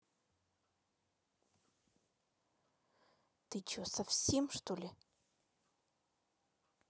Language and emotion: Russian, angry